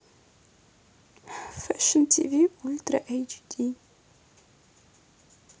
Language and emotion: Russian, neutral